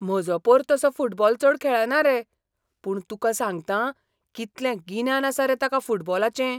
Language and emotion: Goan Konkani, surprised